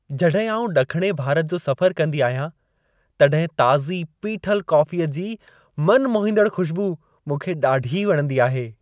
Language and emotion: Sindhi, happy